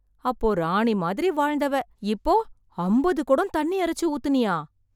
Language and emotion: Tamil, surprised